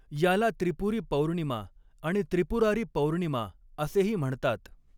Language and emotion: Marathi, neutral